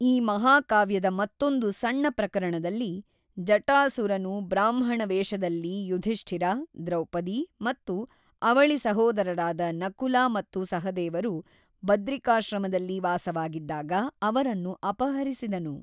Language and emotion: Kannada, neutral